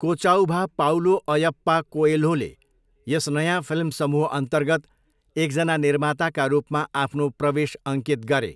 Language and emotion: Nepali, neutral